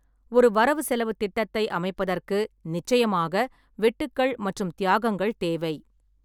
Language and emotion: Tamil, neutral